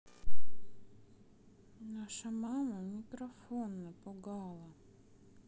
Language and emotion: Russian, sad